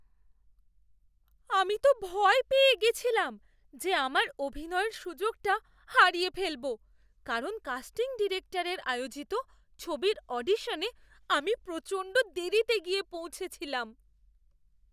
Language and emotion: Bengali, fearful